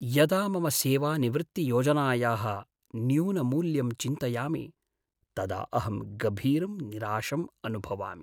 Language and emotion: Sanskrit, sad